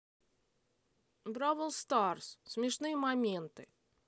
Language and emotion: Russian, neutral